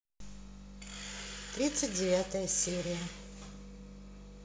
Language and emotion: Russian, neutral